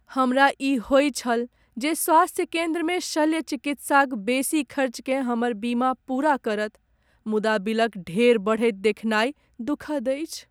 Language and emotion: Maithili, sad